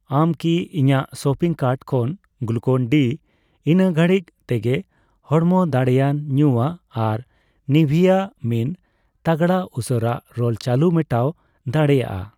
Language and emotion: Santali, neutral